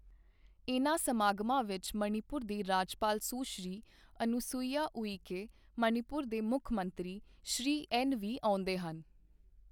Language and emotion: Punjabi, neutral